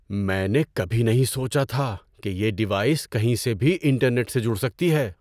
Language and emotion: Urdu, surprised